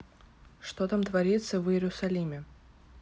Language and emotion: Russian, neutral